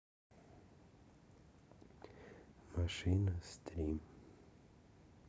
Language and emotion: Russian, sad